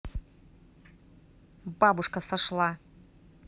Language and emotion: Russian, neutral